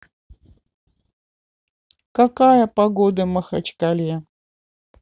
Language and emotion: Russian, neutral